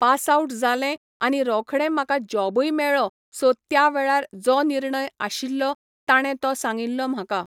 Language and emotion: Goan Konkani, neutral